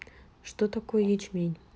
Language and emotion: Russian, neutral